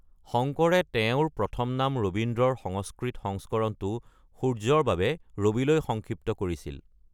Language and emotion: Assamese, neutral